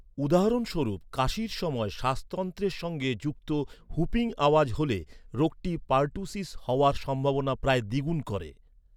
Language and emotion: Bengali, neutral